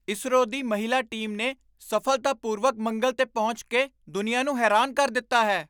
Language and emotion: Punjabi, surprised